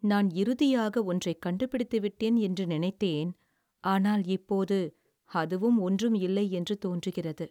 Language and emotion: Tamil, sad